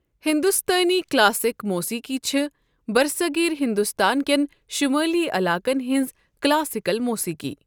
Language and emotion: Kashmiri, neutral